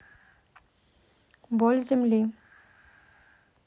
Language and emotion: Russian, neutral